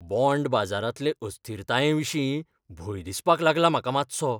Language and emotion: Goan Konkani, fearful